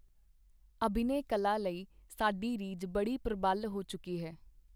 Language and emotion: Punjabi, neutral